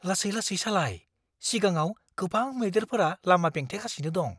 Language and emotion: Bodo, fearful